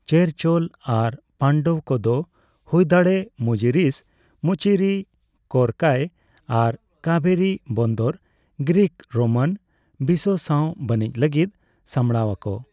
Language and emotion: Santali, neutral